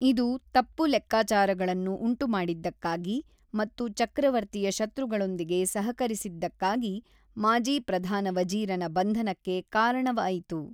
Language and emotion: Kannada, neutral